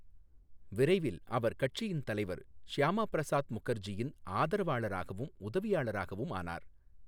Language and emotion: Tamil, neutral